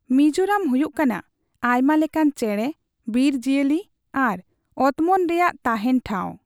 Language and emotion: Santali, neutral